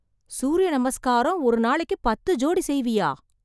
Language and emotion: Tamil, surprised